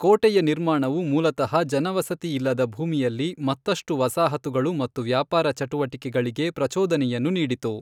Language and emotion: Kannada, neutral